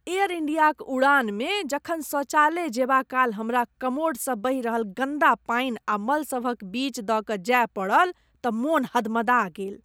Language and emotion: Maithili, disgusted